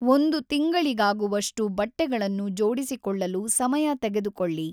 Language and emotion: Kannada, neutral